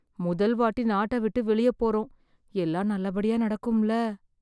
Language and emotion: Tamil, fearful